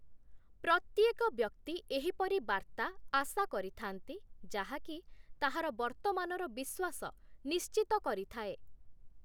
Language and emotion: Odia, neutral